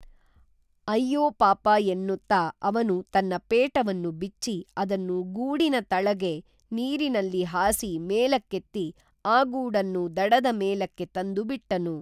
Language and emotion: Kannada, neutral